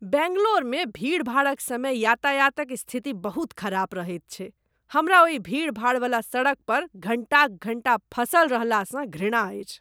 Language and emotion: Maithili, disgusted